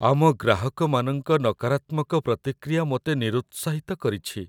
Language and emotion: Odia, sad